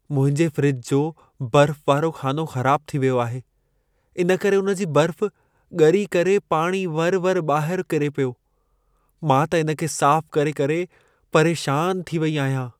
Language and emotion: Sindhi, sad